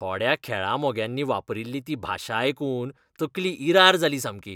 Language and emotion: Goan Konkani, disgusted